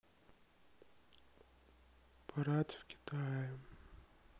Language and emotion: Russian, sad